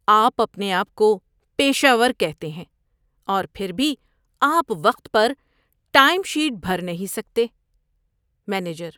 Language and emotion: Urdu, disgusted